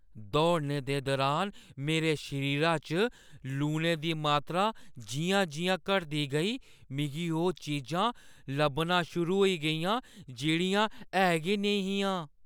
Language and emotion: Dogri, fearful